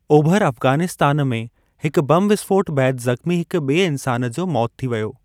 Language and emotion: Sindhi, neutral